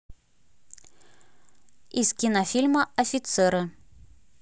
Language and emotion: Russian, neutral